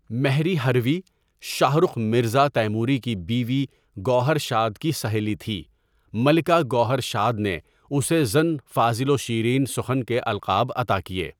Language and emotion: Urdu, neutral